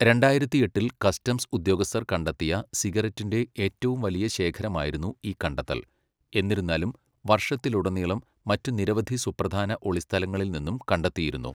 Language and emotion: Malayalam, neutral